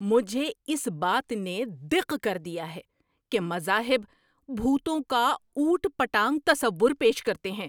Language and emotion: Urdu, angry